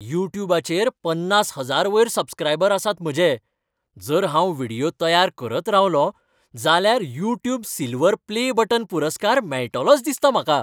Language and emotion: Goan Konkani, happy